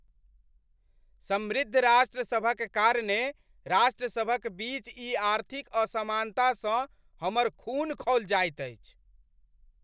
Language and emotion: Maithili, angry